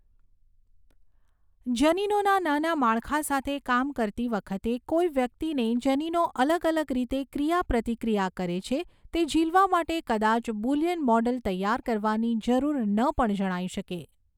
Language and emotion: Gujarati, neutral